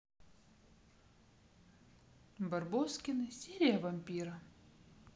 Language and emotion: Russian, neutral